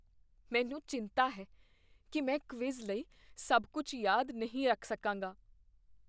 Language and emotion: Punjabi, fearful